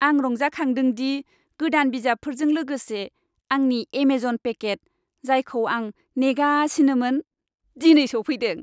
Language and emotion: Bodo, happy